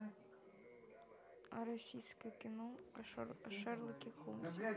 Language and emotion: Russian, neutral